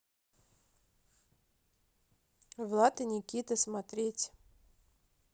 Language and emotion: Russian, neutral